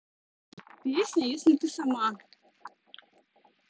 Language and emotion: Russian, neutral